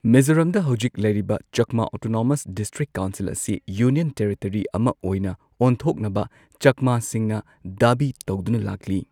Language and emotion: Manipuri, neutral